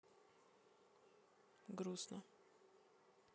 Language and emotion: Russian, sad